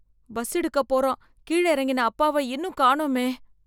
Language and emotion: Tamil, fearful